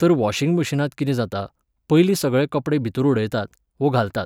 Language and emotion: Goan Konkani, neutral